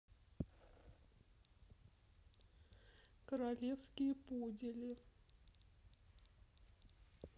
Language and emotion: Russian, sad